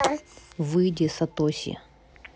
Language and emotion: Russian, angry